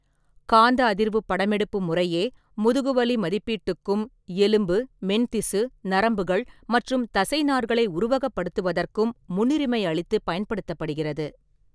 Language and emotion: Tamil, neutral